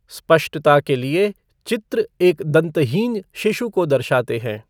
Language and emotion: Hindi, neutral